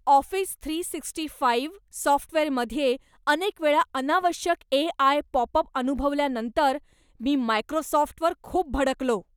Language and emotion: Marathi, angry